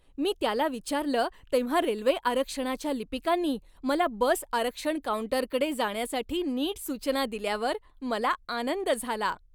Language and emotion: Marathi, happy